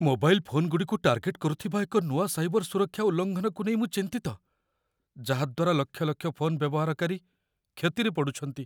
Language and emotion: Odia, fearful